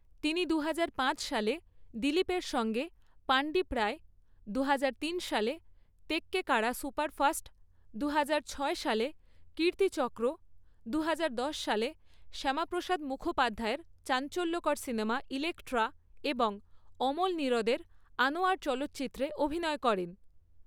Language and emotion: Bengali, neutral